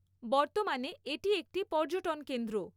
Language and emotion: Bengali, neutral